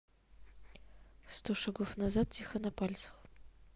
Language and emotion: Russian, neutral